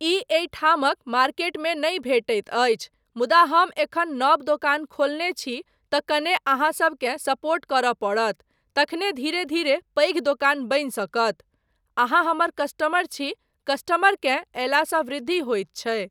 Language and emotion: Maithili, neutral